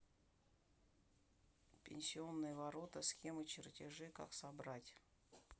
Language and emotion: Russian, neutral